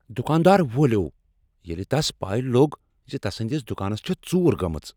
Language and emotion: Kashmiri, angry